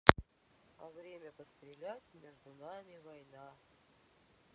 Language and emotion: Russian, neutral